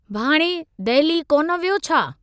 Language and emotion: Sindhi, neutral